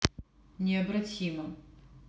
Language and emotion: Russian, neutral